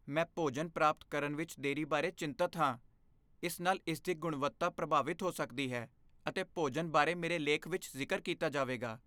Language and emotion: Punjabi, fearful